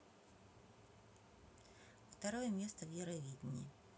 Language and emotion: Russian, neutral